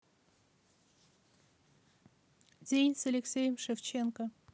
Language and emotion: Russian, neutral